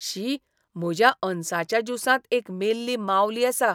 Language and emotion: Goan Konkani, disgusted